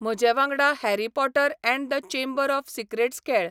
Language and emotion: Goan Konkani, neutral